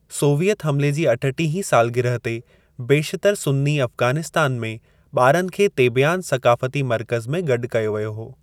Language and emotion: Sindhi, neutral